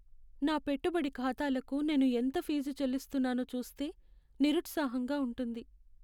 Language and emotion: Telugu, sad